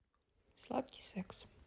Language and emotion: Russian, neutral